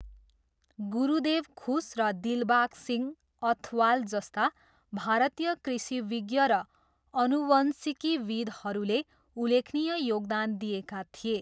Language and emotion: Nepali, neutral